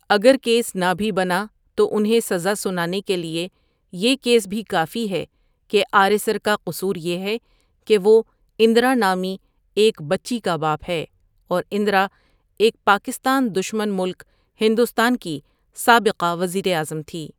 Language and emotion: Urdu, neutral